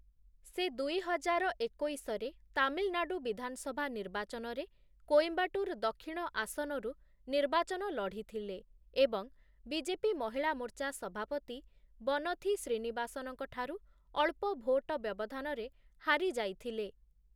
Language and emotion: Odia, neutral